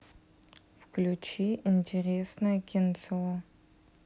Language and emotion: Russian, sad